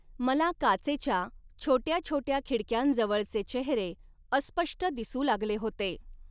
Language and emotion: Marathi, neutral